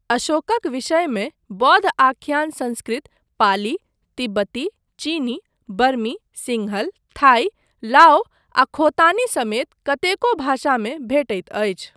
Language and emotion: Maithili, neutral